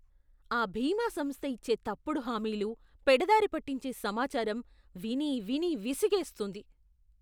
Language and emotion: Telugu, disgusted